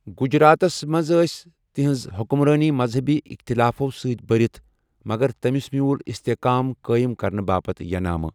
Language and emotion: Kashmiri, neutral